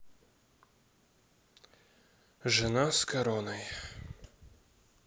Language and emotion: Russian, sad